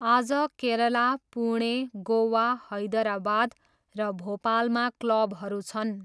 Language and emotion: Nepali, neutral